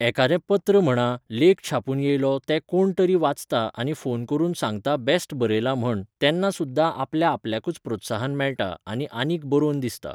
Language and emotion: Goan Konkani, neutral